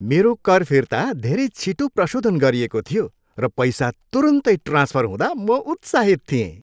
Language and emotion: Nepali, happy